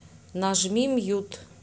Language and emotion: Russian, neutral